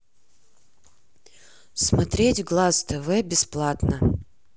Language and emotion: Russian, neutral